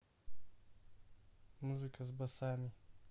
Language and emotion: Russian, neutral